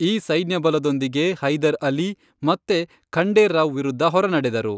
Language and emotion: Kannada, neutral